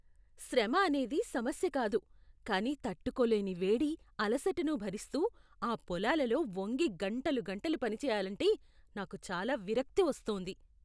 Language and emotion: Telugu, disgusted